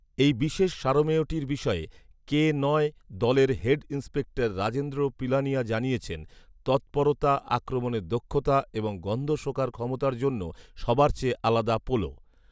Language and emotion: Bengali, neutral